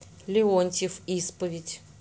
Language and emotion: Russian, neutral